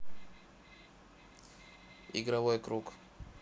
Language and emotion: Russian, neutral